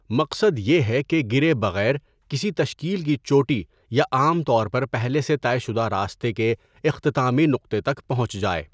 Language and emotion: Urdu, neutral